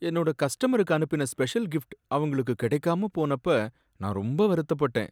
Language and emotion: Tamil, sad